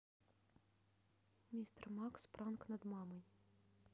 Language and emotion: Russian, neutral